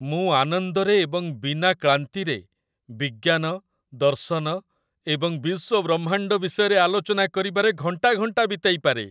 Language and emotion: Odia, happy